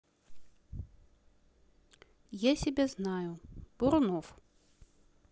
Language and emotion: Russian, neutral